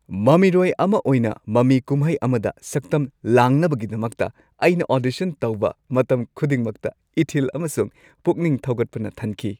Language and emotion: Manipuri, happy